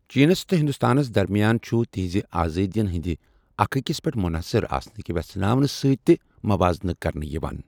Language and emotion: Kashmiri, neutral